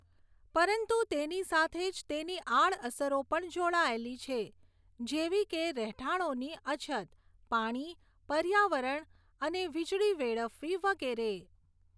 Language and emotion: Gujarati, neutral